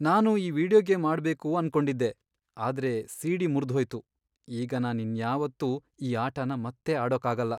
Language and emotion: Kannada, sad